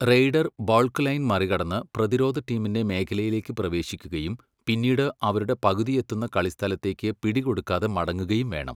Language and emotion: Malayalam, neutral